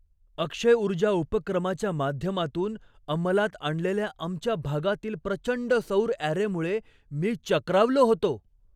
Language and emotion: Marathi, surprised